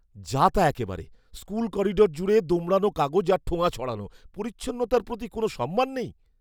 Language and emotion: Bengali, disgusted